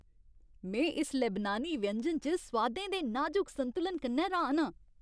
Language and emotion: Dogri, happy